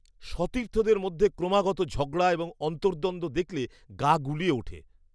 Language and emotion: Bengali, disgusted